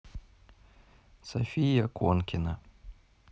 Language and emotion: Russian, neutral